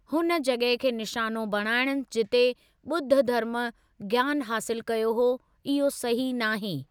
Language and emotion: Sindhi, neutral